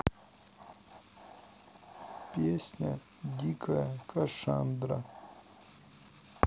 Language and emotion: Russian, sad